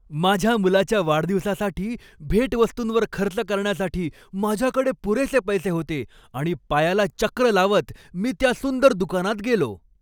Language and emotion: Marathi, happy